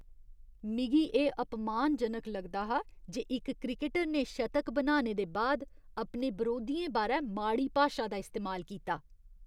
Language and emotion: Dogri, disgusted